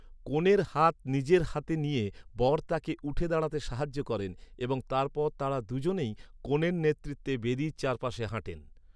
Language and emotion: Bengali, neutral